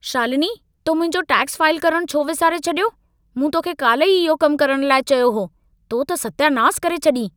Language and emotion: Sindhi, angry